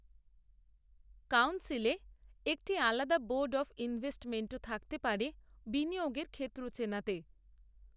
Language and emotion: Bengali, neutral